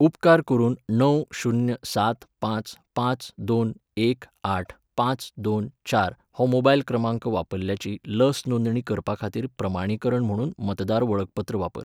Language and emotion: Goan Konkani, neutral